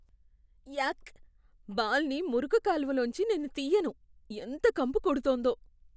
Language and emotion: Telugu, disgusted